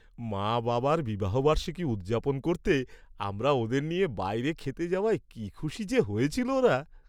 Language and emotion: Bengali, happy